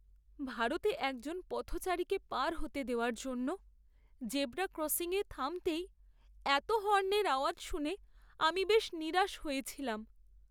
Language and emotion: Bengali, sad